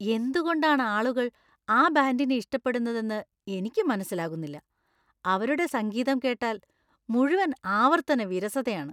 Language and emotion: Malayalam, disgusted